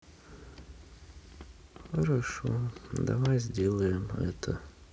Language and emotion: Russian, sad